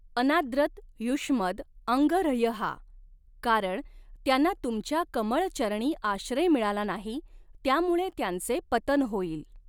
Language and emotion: Marathi, neutral